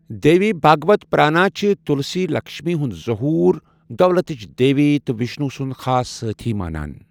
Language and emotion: Kashmiri, neutral